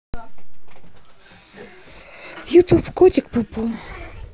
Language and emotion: Russian, neutral